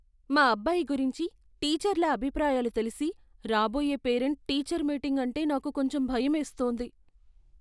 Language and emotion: Telugu, fearful